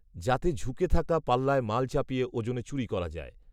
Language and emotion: Bengali, neutral